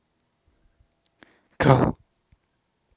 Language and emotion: Russian, neutral